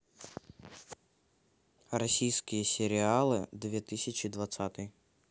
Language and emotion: Russian, neutral